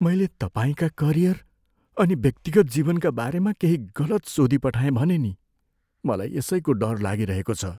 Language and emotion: Nepali, fearful